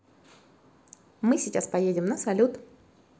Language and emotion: Russian, positive